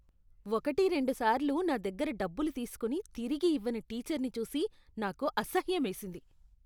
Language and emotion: Telugu, disgusted